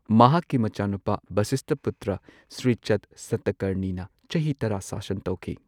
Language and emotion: Manipuri, neutral